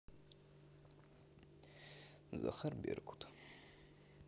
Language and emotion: Russian, neutral